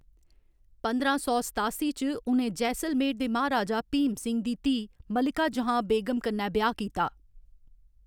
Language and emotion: Dogri, neutral